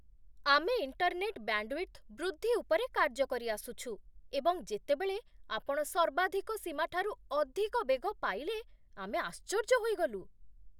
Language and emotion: Odia, surprised